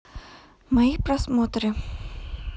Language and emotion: Russian, neutral